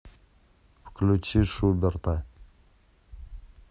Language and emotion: Russian, neutral